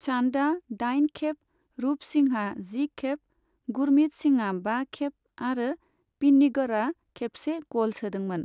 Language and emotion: Bodo, neutral